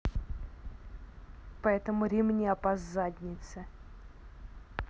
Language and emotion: Russian, angry